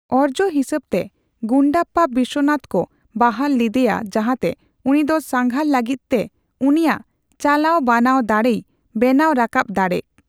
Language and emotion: Santali, neutral